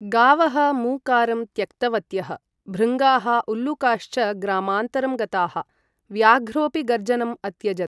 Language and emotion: Sanskrit, neutral